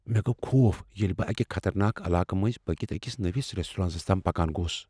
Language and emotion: Kashmiri, fearful